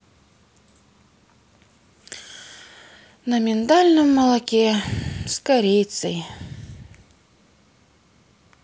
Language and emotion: Russian, sad